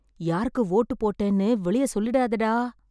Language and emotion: Tamil, fearful